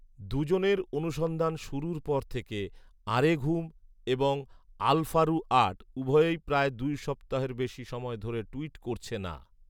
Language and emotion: Bengali, neutral